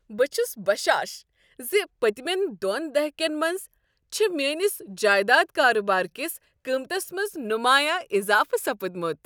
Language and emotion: Kashmiri, happy